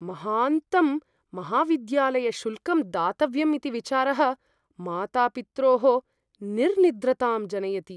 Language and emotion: Sanskrit, fearful